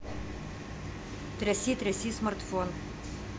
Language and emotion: Russian, neutral